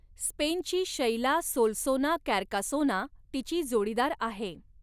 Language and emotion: Marathi, neutral